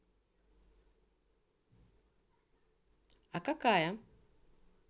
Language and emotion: Russian, neutral